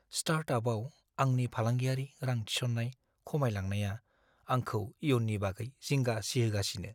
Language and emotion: Bodo, fearful